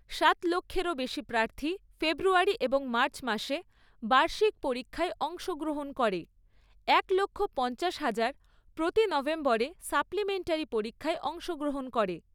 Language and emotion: Bengali, neutral